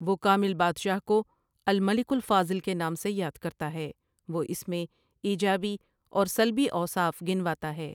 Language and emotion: Urdu, neutral